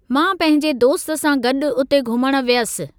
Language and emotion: Sindhi, neutral